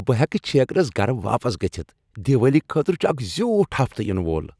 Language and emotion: Kashmiri, happy